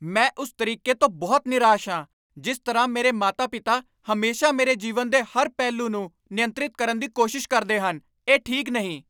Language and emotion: Punjabi, angry